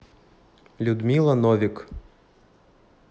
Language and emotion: Russian, neutral